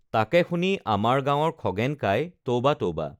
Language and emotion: Assamese, neutral